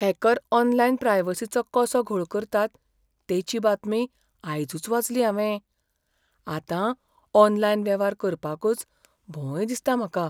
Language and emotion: Goan Konkani, fearful